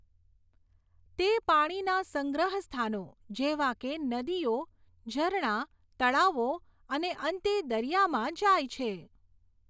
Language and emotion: Gujarati, neutral